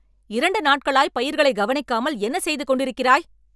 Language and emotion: Tamil, angry